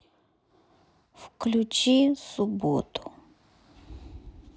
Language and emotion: Russian, neutral